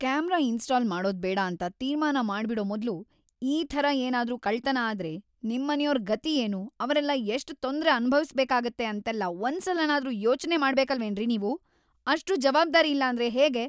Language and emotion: Kannada, angry